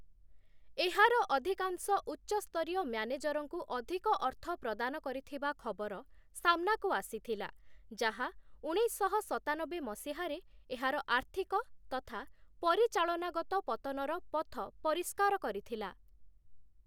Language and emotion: Odia, neutral